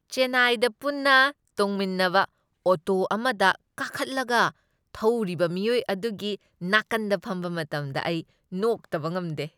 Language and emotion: Manipuri, happy